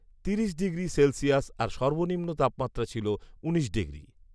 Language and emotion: Bengali, neutral